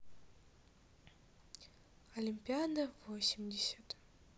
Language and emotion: Russian, neutral